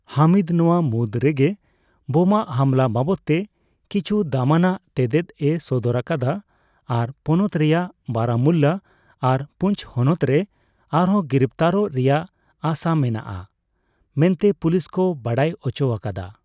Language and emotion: Santali, neutral